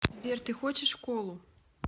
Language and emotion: Russian, neutral